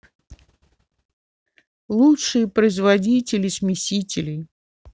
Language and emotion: Russian, neutral